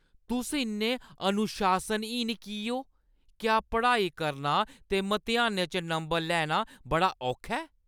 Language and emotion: Dogri, angry